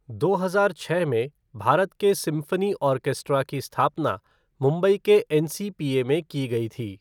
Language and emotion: Hindi, neutral